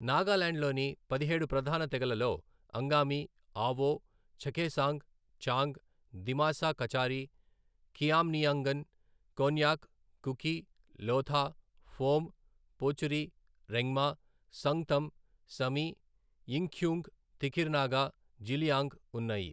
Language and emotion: Telugu, neutral